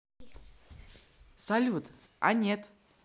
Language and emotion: Russian, neutral